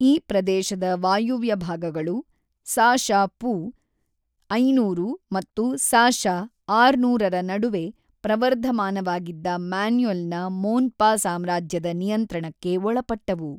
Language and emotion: Kannada, neutral